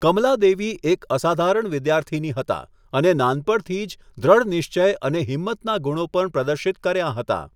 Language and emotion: Gujarati, neutral